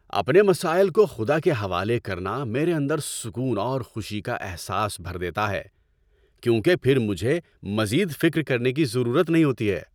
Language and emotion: Urdu, happy